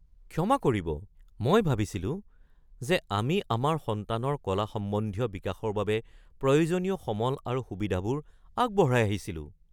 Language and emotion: Assamese, surprised